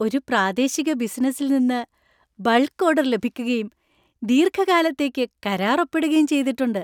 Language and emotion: Malayalam, happy